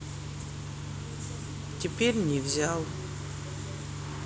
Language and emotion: Russian, sad